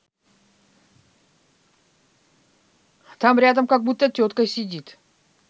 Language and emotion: Russian, neutral